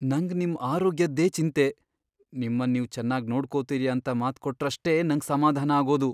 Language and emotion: Kannada, fearful